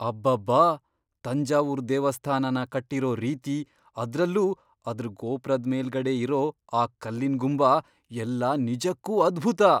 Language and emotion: Kannada, surprised